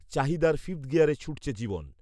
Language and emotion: Bengali, neutral